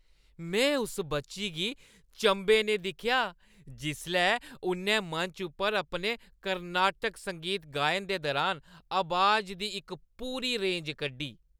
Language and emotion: Dogri, happy